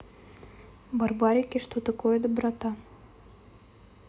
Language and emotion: Russian, neutral